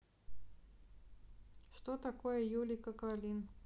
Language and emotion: Russian, neutral